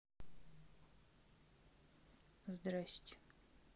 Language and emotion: Russian, neutral